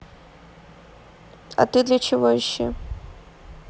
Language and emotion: Russian, neutral